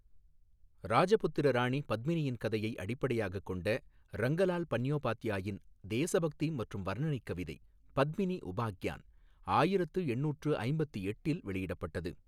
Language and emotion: Tamil, neutral